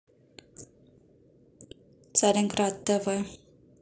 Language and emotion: Russian, neutral